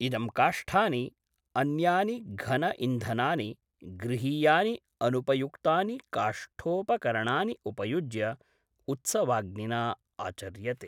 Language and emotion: Sanskrit, neutral